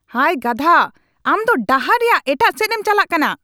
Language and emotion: Santali, angry